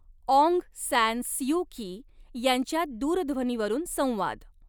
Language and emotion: Marathi, neutral